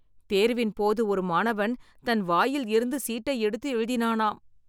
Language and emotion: Tamil, disgusted